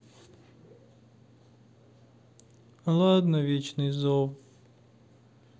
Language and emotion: Russian, sad